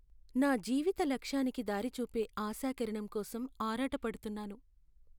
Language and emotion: Telugu, sad